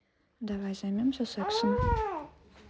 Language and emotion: Russian, neutral